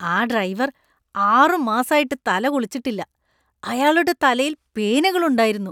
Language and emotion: Malayalam, disgusted